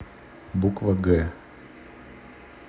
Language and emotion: Russian, neutral